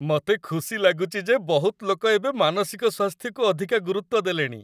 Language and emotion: Odia, happy